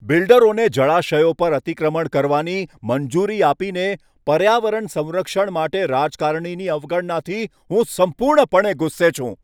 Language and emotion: Gujarati, angry